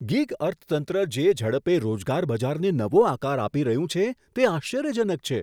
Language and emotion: Gujarati, surprised